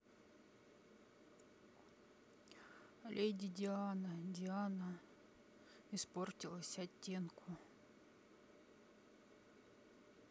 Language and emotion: Russian, sad